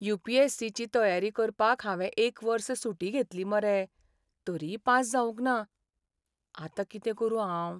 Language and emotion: Goan Konkani, sad